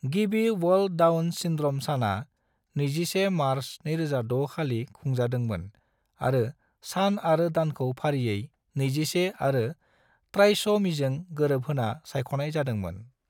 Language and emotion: Bodo, neutral